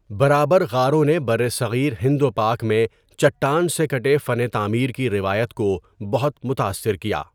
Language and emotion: Urdu, neutral